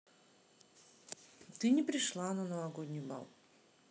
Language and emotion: Russian, neutral